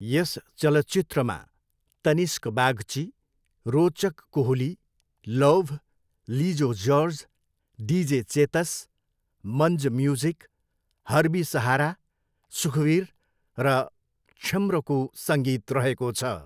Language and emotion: Nepali, neutral